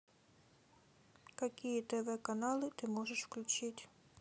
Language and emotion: Russian, neutral